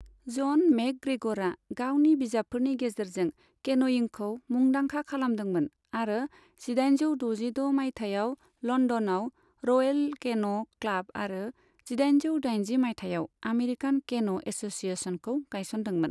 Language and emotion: Bodo, neutral